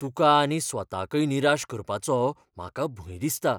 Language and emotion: Goan Konkani, fearful